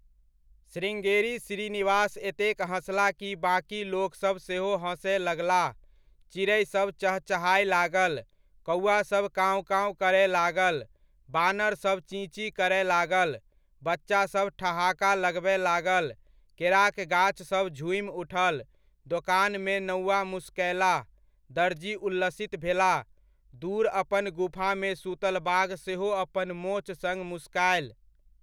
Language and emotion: Maithili, neutral